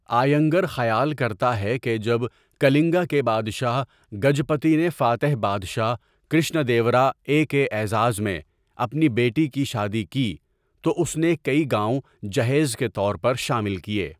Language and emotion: Urdu, neutral